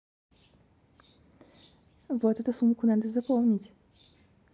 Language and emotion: Russian, neutral